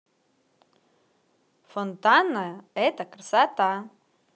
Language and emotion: Russian, positive